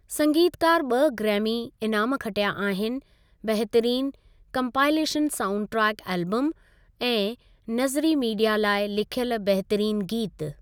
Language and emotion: Sindhi, neutral